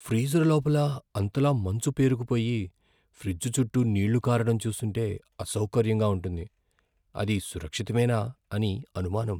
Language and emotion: Telugu, fearful